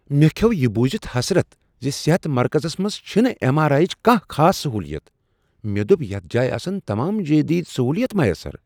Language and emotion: Kashmiri, surprised